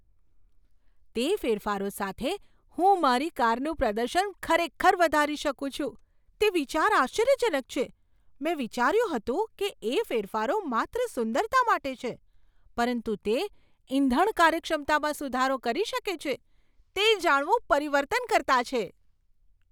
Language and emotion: Gujarati, surprised